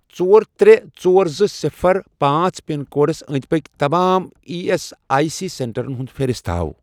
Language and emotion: Kashmiri, neutral